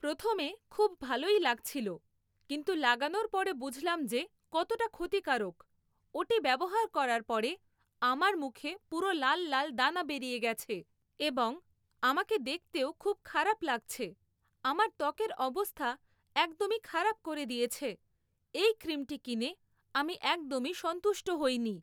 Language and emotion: Bengali, neutral